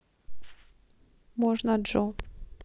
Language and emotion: Russian, neutral